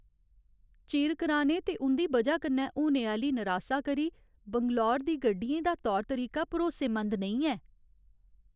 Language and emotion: Dogri, sad